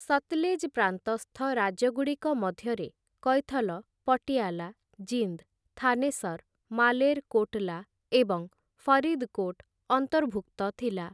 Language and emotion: Odia, neutral